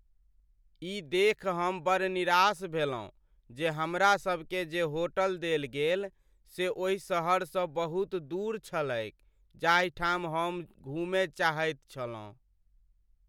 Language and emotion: Maithili, sad